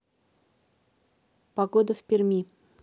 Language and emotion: Russian, neutral